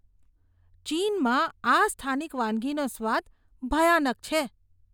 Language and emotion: Gujarati, disgusted